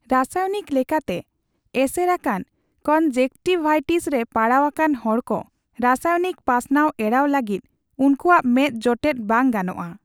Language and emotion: Santali, neutral